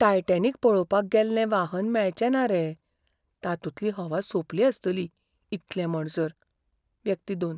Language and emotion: Goan Konkani, fearful